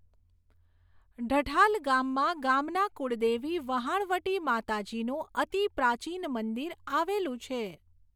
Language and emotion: Gujarati, neutral